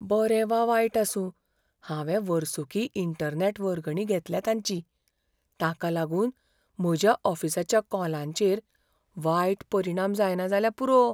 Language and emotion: Goan Konkani, fearful